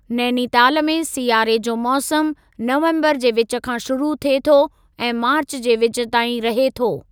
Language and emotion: Sindhi, neutral